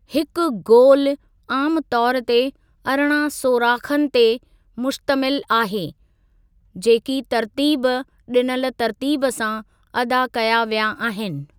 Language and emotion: Sindhi, neutral